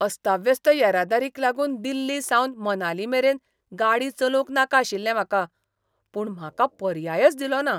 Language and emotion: Goan Konkani, disgusted